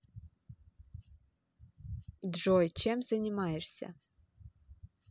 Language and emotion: Russian, neutral